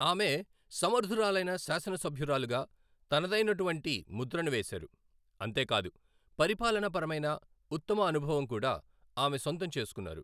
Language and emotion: Telugu, neutral